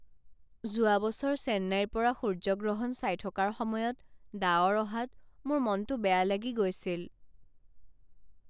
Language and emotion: Assamese, sad